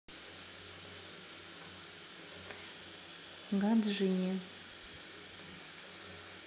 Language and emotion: Russian, neutral